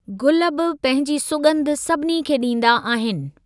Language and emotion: Sindhi, neutral